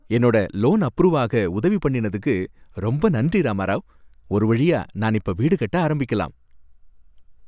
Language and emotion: Tamil, happy